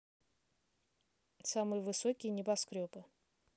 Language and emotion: Russian, neutral